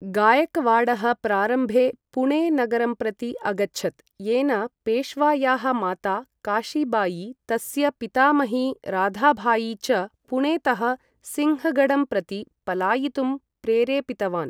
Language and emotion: Sanskrit, neutral